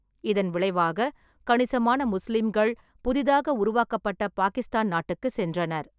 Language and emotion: Tamil, neutral